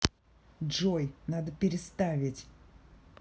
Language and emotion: Russian, angry